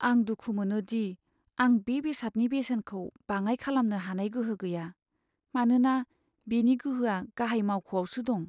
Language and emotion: Bodo, sad